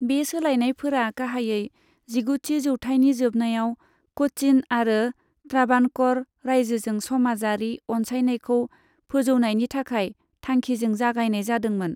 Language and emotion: Bodo, neutral